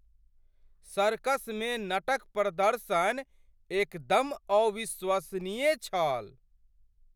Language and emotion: Maithili, surprised